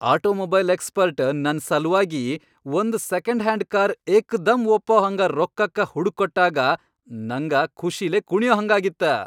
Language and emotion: Kannada, happy